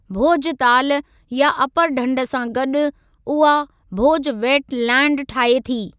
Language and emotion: Sindhi, neutral